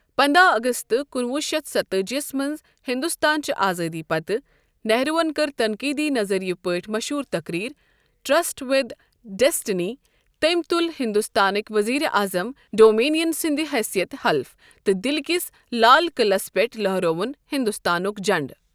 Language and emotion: Kashmiri, neutral